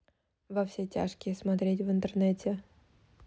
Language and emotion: Russian, neutral